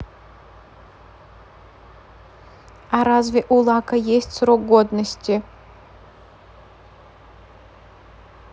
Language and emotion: Russian, neutral